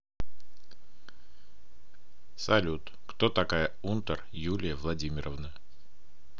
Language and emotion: Russian, neutral